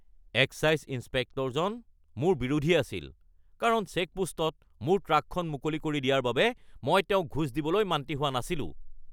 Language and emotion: Assamese, angry